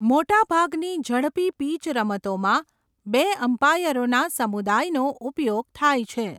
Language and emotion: Gujarati, neutral